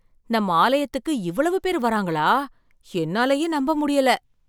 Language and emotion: Tamil, surprised